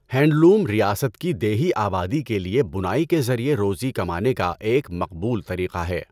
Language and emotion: Urdu, neutral